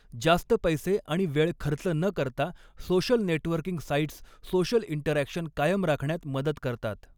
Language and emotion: Marathi, neutral